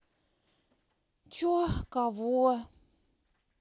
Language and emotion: Russian, angry